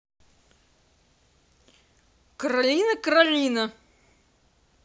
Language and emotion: Russian, angry